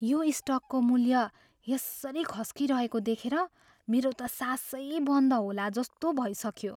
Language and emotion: Nepali, fearful